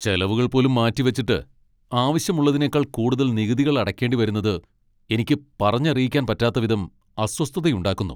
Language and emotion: Malayalam, angry